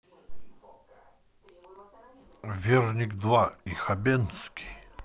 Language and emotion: Russian, neutral